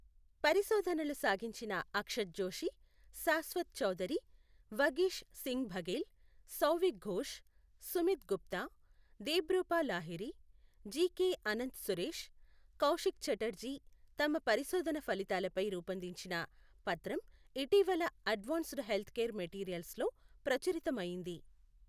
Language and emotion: Telugu, neutral